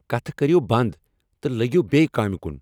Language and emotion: Kashmiri, angry